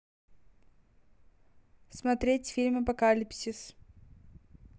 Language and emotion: Russian, neutral